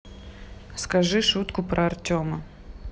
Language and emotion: Russian, neutral